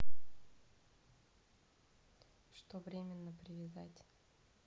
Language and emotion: Russian, neutral